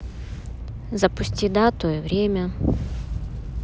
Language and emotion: Russian, neutral